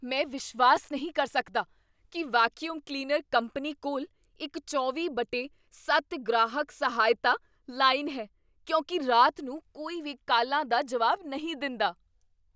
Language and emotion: Punjabi, surprised